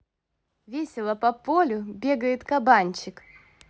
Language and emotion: Russian, positive